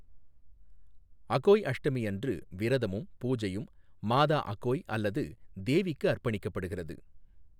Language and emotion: Tamil, neutral